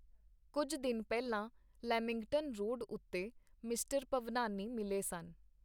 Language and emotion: Punjabi, neutral